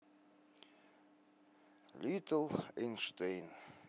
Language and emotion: Russian, sad